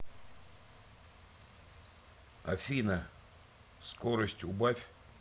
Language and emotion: Russian, neutral